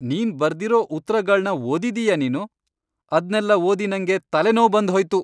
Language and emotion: Kannada, angry